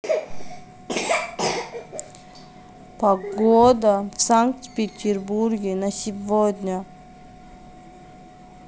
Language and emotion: Russian, neutral